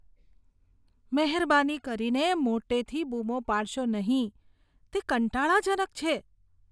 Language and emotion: Gujarati, disgusted